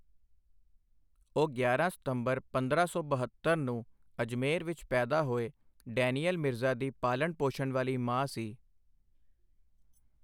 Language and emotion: Punjabi, neutral